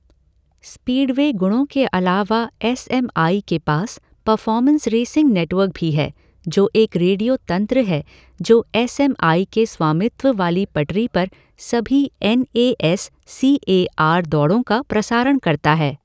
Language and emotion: Hindi, neutral